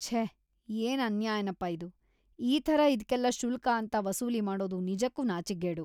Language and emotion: Kannada, disgusted